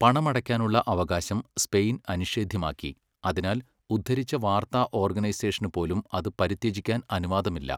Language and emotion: Malayalam, neutral